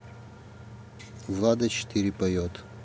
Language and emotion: Russian, neutral